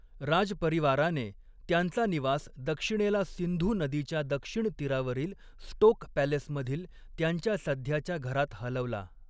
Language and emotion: Marathi, neutral